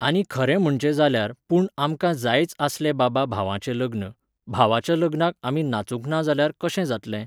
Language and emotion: Goan Konkani, neutral